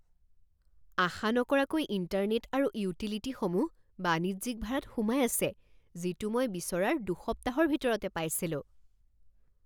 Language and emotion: Assamese, surprised